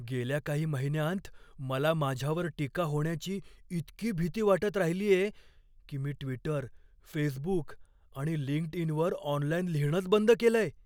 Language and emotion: Marathi, fearful